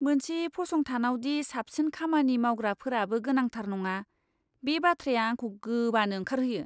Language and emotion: Bodo, disgusted